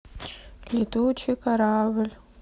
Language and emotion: Russian, sad